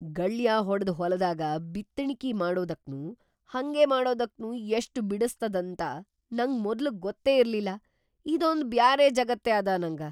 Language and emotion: Kannada, surprised